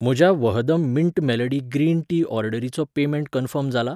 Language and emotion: Goan Konkani, neutral